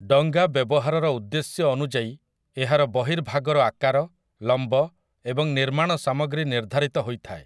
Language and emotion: Odia, neutral